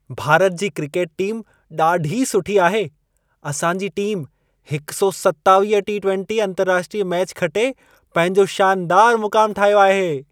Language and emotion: Sindhi, happy